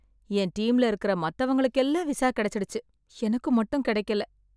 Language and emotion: Tamil, sad